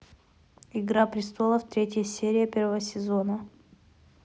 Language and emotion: Russian, neutral